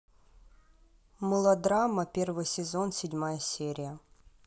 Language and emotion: Russian, neutral